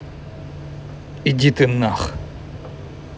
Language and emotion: Russian, angry